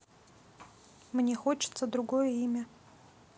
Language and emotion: Russian, neutral